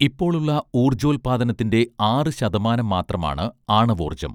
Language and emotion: Malayalam, neutral